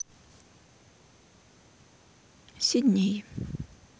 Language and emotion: Russian, sad